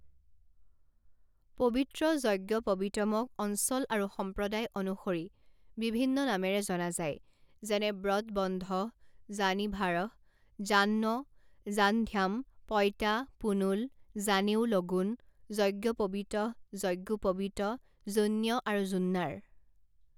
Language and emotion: Assamese, neutral